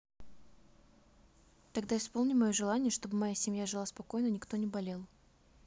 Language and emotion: Russian, neutral